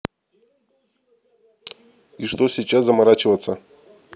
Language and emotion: Russian, neutral